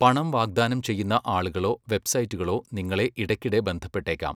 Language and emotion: Malayalam, neutral